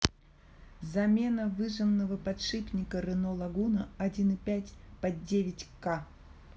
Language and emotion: Russian, neutral